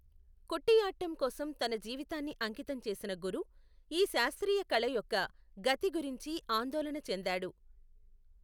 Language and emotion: Telugu, neutral